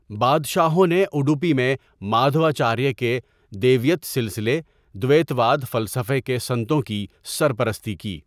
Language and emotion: Urdu, neutral